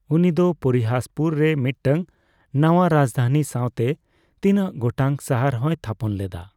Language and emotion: Santali, neutral